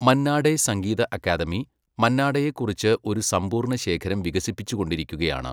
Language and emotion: Malayalam, neutral